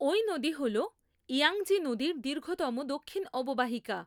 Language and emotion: Bengali, neutral